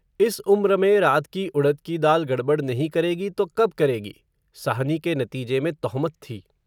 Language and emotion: Hindi, neutral